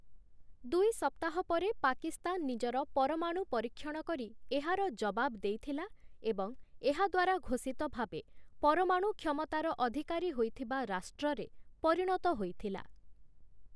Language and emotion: Odia, neutral